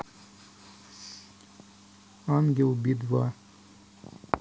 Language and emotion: Russian, neutral